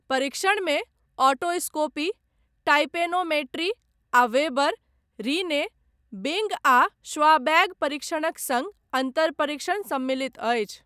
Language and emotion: Maithili, neutral